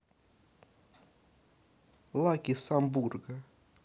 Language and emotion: Russian, neutral